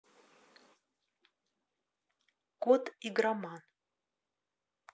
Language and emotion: Russian, neutral